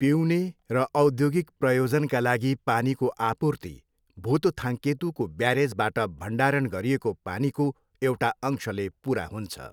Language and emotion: Nepali, neutral